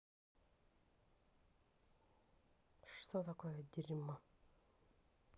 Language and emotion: Russian, neutral